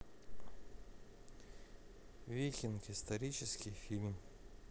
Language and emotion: Russian, neutral